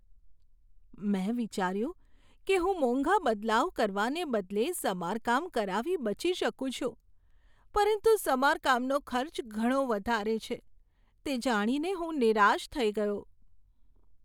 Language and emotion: Gujarati, sad